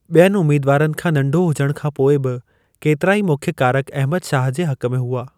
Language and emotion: Sindhi, neutral